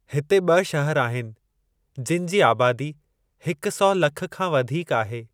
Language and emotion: Sindhi, neutral